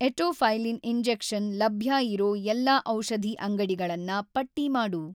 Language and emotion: Kannada, neutral